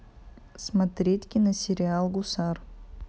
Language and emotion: Russian, neutral